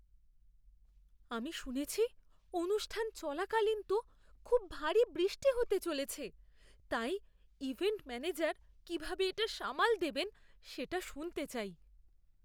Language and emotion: Bengali, fearful